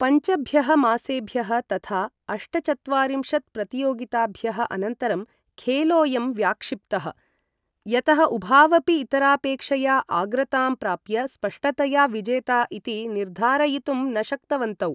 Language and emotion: Sanskrit, neutral